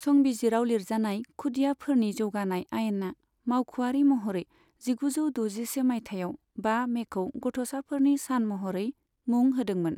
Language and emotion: Bodo, neutral